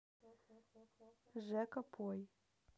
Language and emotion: Russian, neutral